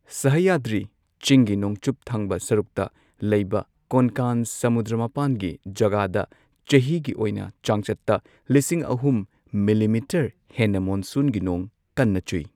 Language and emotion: Manipuri, neutral